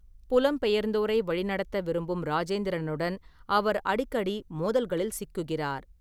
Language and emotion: Tamil, neutral